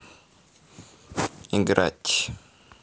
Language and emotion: Russian, neutral